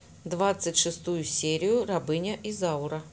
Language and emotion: Russian, neutral